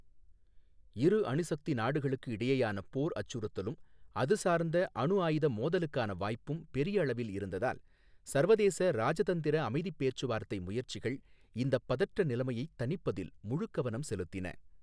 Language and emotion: Tamil, neutral